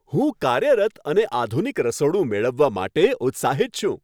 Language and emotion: Gujarati, happy